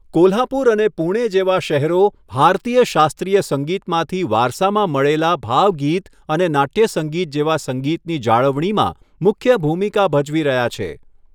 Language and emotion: Gujarati, neutral